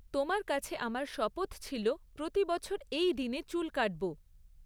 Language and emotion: Bengali, neutral